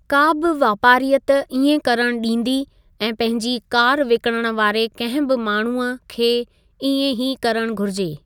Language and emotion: Sindhi, neutral